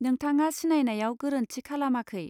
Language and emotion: Bodo, neutral